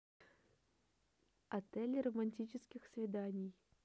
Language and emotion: Russian, neutral